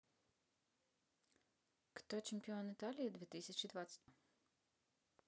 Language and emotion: Russian, neutral